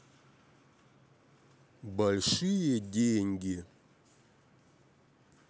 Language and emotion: Russian, neutral